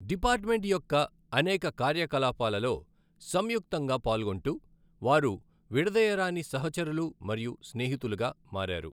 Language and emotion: Telugu, neutral